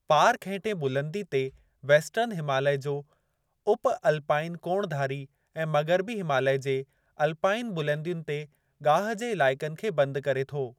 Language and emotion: Sindhi, neutral